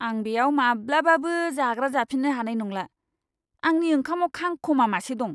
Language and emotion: Bodo, disgusted